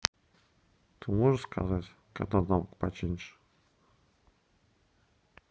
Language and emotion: Russian, neutral